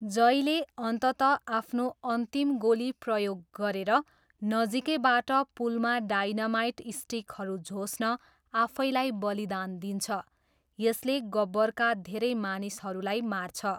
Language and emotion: Nepali, neutral